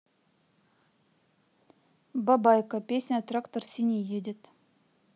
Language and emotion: Russian, neutral